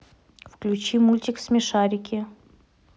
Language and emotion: Russian, neutral